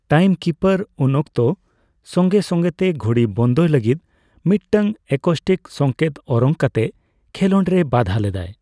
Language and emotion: Santali, neutral